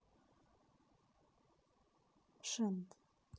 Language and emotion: Russian, neutral